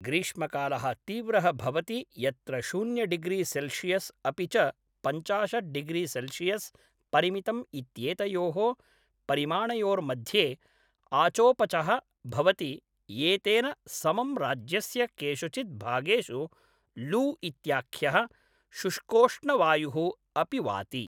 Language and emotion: Sanskrit, neutral